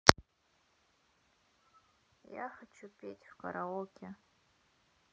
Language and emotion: Russian, sad